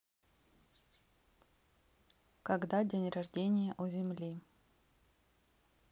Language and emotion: Russian, neutral